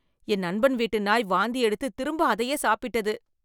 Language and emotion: Tamil, disgusted